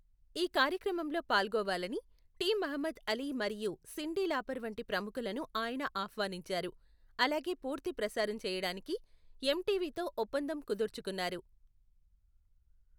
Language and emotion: Telugu, neutral